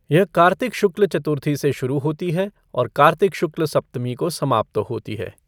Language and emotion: Hindi, neutral